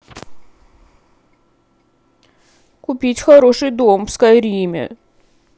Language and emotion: Russian, sad